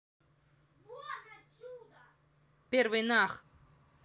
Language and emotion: Russian, angry